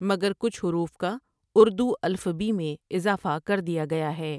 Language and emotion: Urdu, neutral